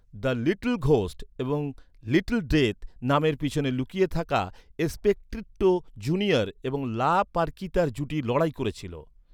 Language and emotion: Bengali, neutral